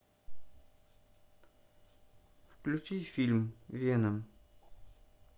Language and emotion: Russian, neutral